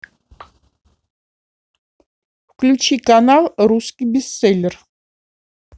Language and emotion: Russian, neutral